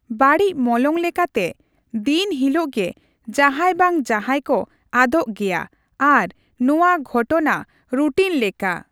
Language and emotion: Santali, neutral